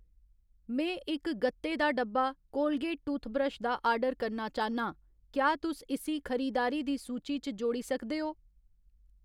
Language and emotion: Dogri, neutral